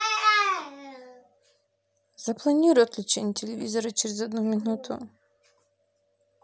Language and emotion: Russian, sad